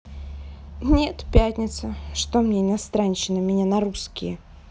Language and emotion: Russian, sad